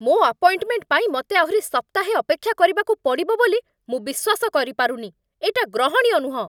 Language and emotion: Odia, angry